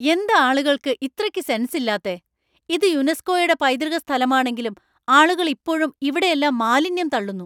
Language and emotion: Malayalam, angry